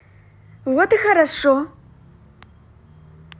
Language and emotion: Russian, positive